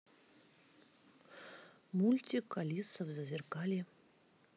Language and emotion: Russian, neutral